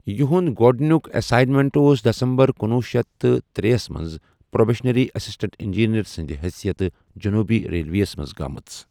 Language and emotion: Kashmiri, neutral